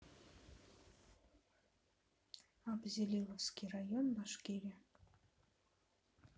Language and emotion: Russian, neutral